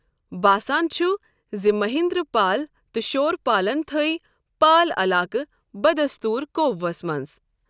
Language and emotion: Kashmiri, neutral